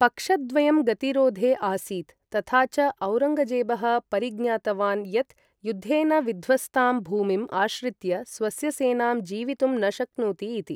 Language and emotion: Sanskrit, neutral